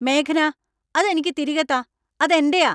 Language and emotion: Malayalam, angry